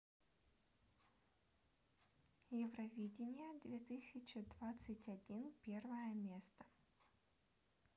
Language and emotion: Russian, neutral